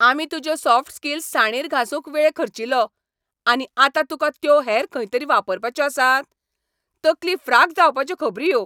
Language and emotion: Goan Konkani, angry